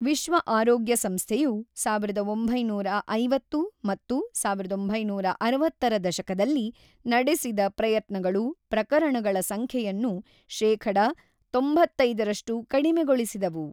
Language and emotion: Kannada, neutral